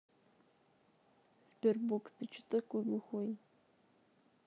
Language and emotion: Russian, neutral